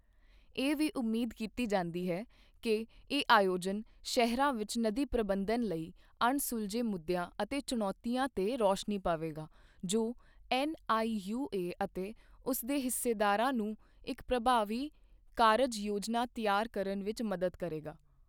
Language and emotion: Punjabi, neutral